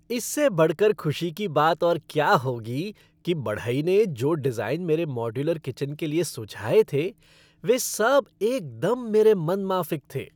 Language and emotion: Hindi, happy